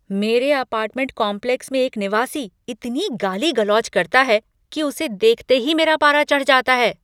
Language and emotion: Hindi, angry